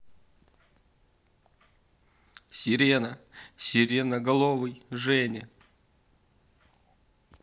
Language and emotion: Russian, neutral